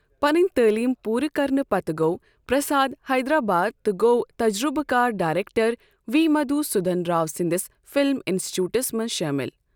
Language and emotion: Kashmiri, neutral